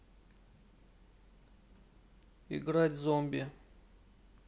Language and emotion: Russian, neutral